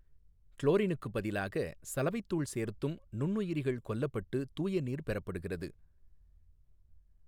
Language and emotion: Tamil, neutral